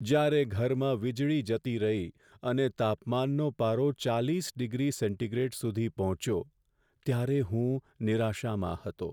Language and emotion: Gujarati, sad